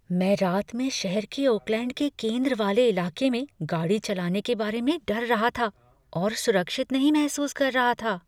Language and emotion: Hindi, fearful